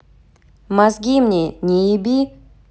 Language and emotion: Russian, angry